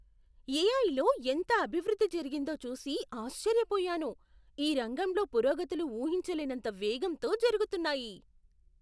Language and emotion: Telugu, surprised